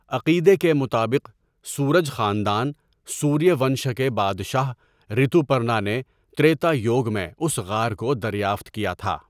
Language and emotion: Urdu, neutral